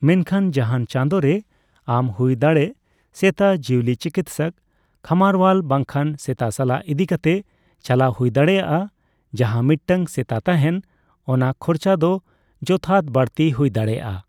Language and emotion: Santali, neutral